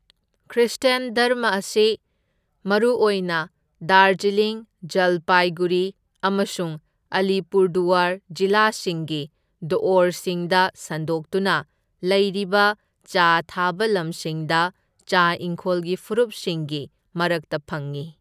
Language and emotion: Manipuri, neutral